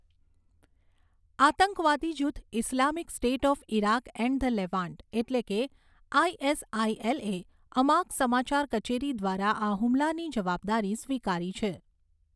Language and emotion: Gujarati, neutral